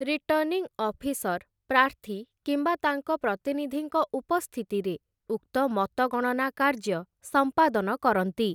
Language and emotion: Odia, neutral